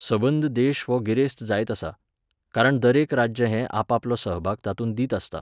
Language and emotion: Goan Konkani, neutral